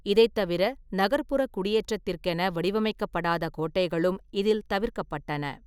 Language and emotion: Tamil, neutral